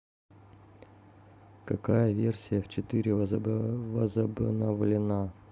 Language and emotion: Russian, neutral